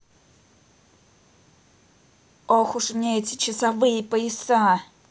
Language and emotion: Russian, angry